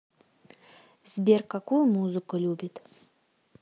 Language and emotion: Russian, neutral